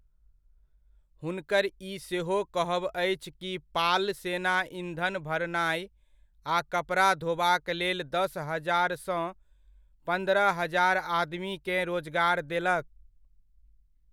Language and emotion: Maithili, neutral